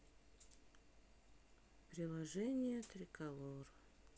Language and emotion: Russian, sad